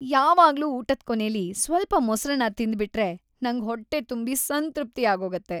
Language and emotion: Kannada, happy